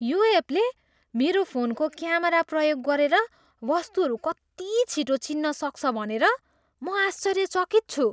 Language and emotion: Nepali, surprised